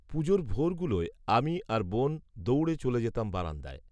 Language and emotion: Bengali, neutral